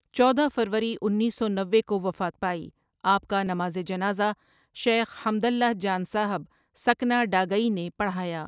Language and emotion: Urdu, neutral